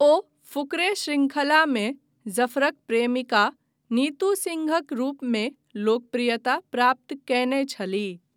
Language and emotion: Maithili, neutral